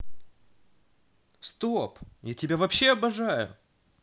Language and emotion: Russian, positive